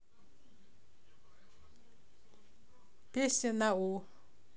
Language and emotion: Russian, neutral